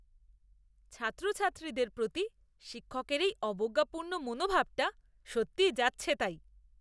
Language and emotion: Bengali, disgusted